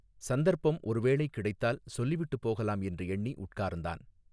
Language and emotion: Tamil, neutral